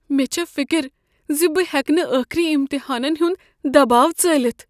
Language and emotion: Kashmiri, fearful